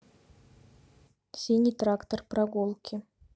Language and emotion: Russian, neutral